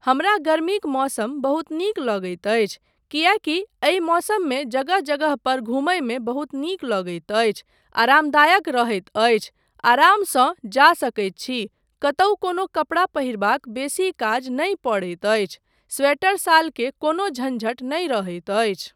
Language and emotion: Maithili, neutral